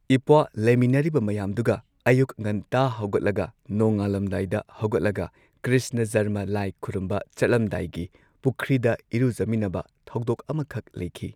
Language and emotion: Manipuri, neutral